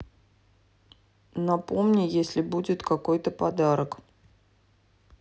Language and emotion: Russian, neutral